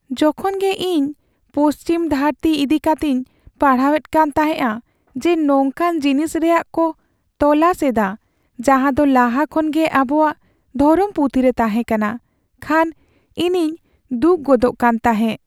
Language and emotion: Santali, sad